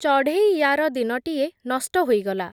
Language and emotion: Odia, neutral